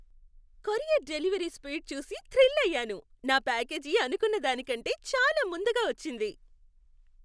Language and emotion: Telugu, happy